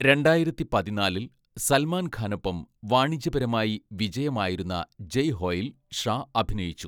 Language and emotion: Malayalam, neutral